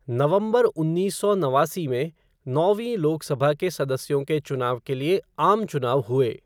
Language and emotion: Hindi, neutral